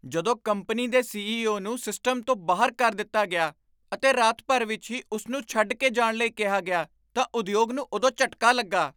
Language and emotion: Punjabi, surprised